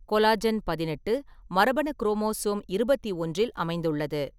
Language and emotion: Tamil, neutral